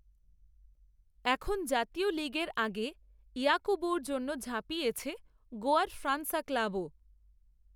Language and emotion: Bengali, neutral